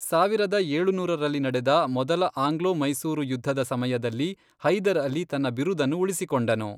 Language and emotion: Kannada, neutral